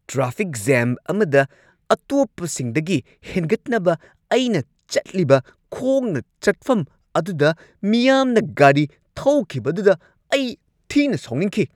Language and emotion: Manipuri, angry